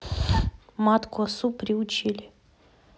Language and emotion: Russian, neutral